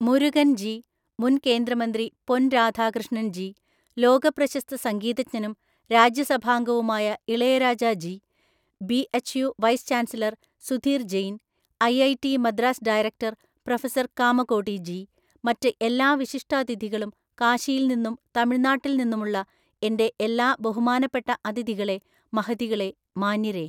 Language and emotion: Malayalam, neutral